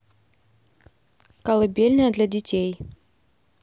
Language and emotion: Russian, neutral